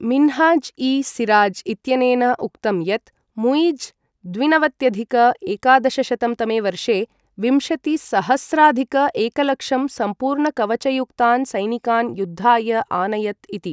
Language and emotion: Sanskrit, neutral